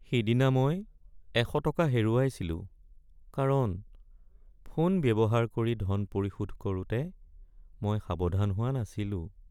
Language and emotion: Assamese, sad